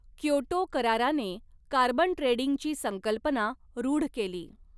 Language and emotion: Marathi, neutral